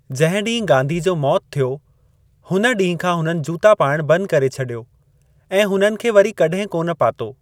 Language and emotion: Sindhi, neutral